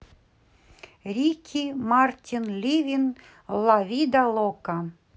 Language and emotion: Russian, positive